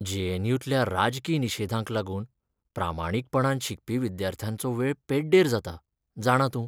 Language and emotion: Goan Konkani, sad